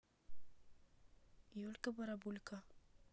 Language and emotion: Russian, neutral